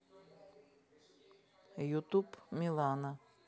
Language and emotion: Russian, neutral